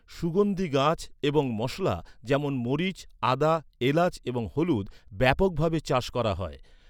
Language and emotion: Bengali, neutral